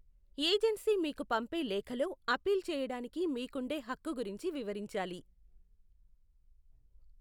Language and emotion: Telugu, neutral